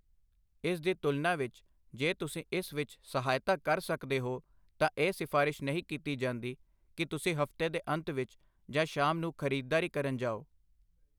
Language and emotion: Punjabi, neutral